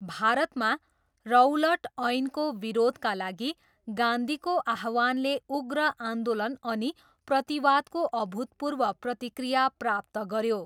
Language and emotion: Nepali, neutral